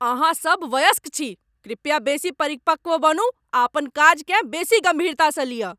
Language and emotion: Maithili, angry